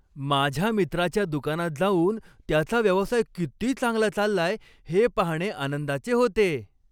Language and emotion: Marathi, happy